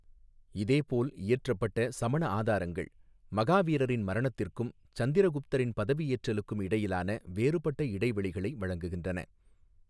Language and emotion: Tamil, neutral